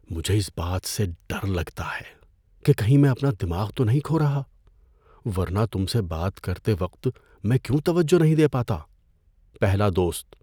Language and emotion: Urdu, fearful